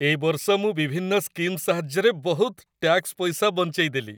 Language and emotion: Odia, happy